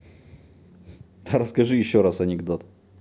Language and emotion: Russian, positive